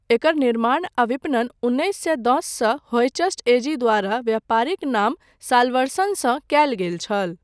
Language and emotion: Maithili, neutral